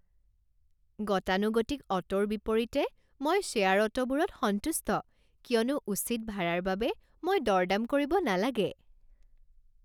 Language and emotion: Assamese, happy